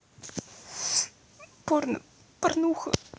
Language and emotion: Russian, sad